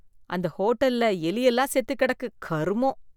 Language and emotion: Tamil, disgusted